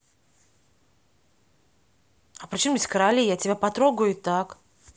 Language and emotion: Russian, angry